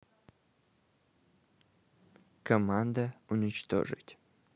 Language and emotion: Russian, neutral